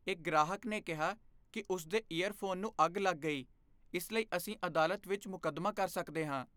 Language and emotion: Punjabi, fearful